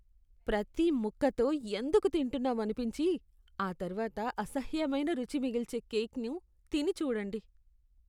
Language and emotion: Telugu, disgusted